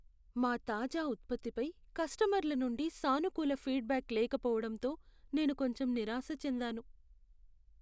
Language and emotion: Telugu, sad